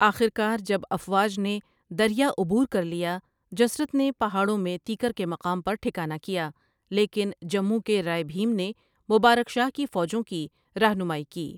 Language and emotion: Urdu, neutral